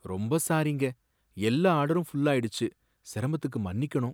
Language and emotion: Tamil, sad